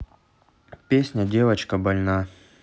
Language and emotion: Russian, neutral